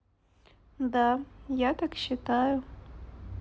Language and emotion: Russian, neutral